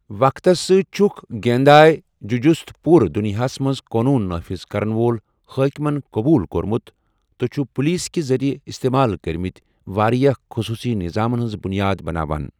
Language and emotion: Kashmiri, neutral